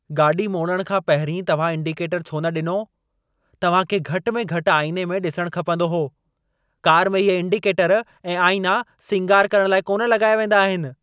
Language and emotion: Sindhi, angry